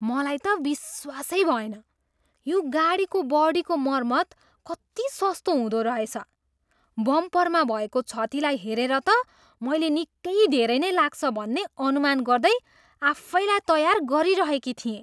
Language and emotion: Nepali, surprised